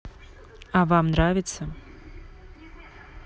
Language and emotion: Russian, neutral